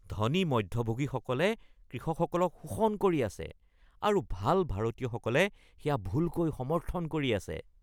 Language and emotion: Assamese, disgusted